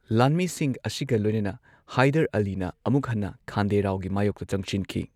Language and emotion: Manipuri, neutral